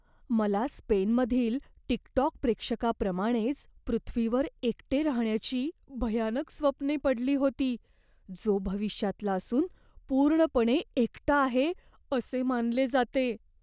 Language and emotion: Marathi, fearful